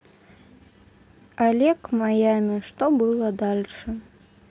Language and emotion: Russian, neutral